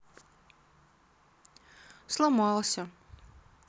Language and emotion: Russian, sad